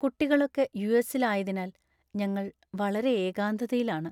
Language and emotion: Malayalam, sad